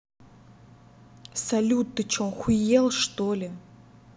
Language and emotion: Russian, angry